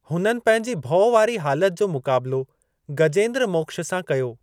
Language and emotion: Sindhi, neutral